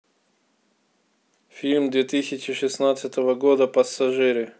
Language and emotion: Russian, neutral